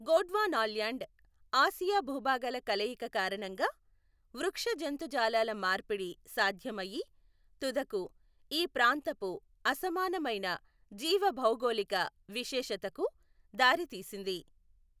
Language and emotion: Telugu, neutral